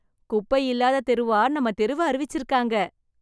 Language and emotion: Tamil, happy